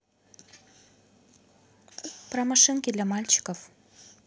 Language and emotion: Russian, neutral